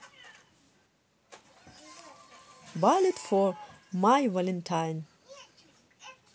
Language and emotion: Russian, positive